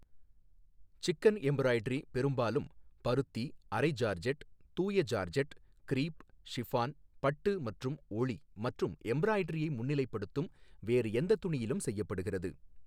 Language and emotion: Tamil, neutral